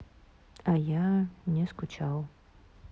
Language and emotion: Russian, neutral